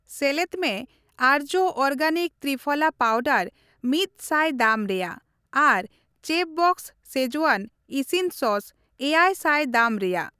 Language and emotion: Santali, neutral